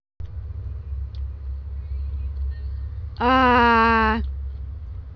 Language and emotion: Russian, neutral